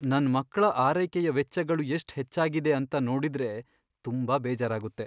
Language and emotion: Kannada, sad